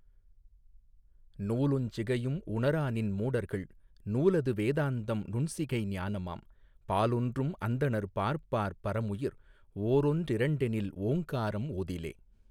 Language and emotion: Tamil, neutral